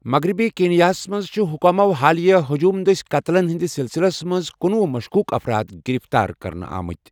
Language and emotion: Kashmiri, neutral